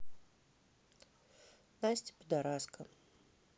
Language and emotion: Russian, neutral